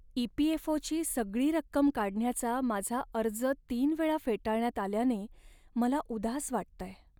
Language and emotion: Marathi, sad